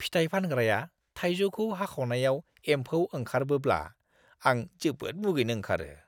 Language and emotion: Bodo, disgusted